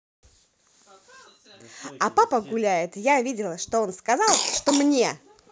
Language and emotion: Russian, positive